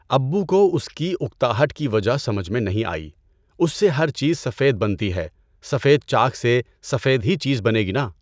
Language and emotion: Urdu, neutral